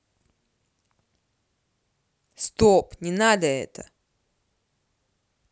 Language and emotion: Russian, angry